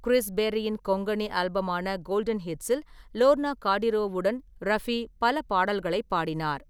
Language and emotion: Tamil, neutral